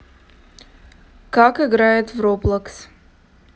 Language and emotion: Russian, neutral